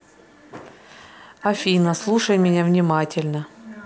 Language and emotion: Russian, neutral